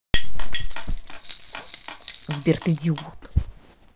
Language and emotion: Russian, angry